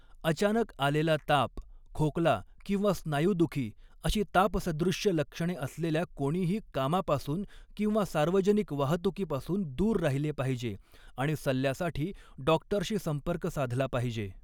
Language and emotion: Marathi, neutral